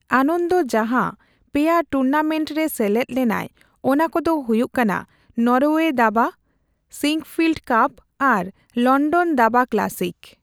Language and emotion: Santali, neutral